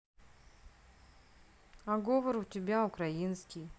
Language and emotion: Russian, neutral